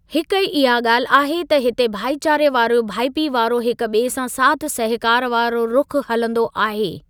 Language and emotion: Sindhi, neutral